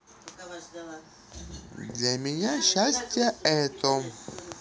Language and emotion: Russian, neutral